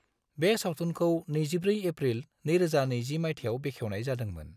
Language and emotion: Bodo, neutral